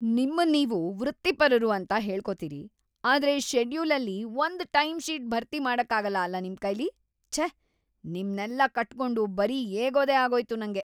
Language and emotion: Kannada, disgusted